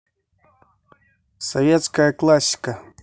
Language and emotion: Russian, neutral